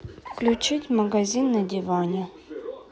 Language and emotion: Russian, neutral